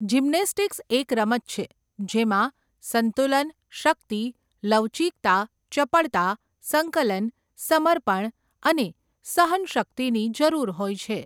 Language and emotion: Gujarati, neutral